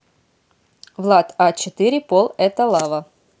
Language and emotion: Russian, neutral